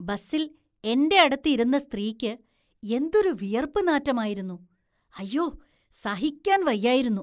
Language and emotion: Malayalam, disgusted